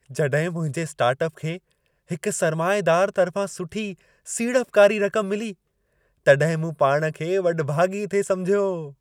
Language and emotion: Sindhi, happy